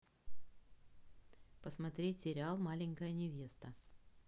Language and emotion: Russian, neutral